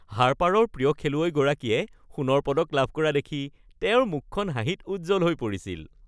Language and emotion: Assamese, happy